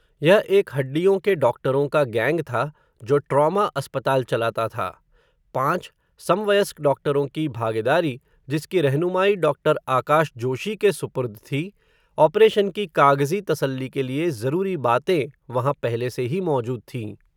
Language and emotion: Hindi, neutral